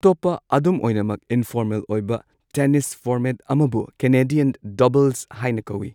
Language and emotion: Manipuri, neutral